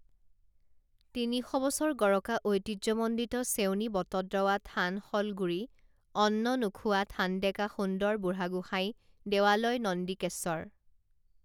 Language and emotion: Assamese, neutral